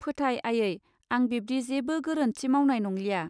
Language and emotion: Bodo, neutral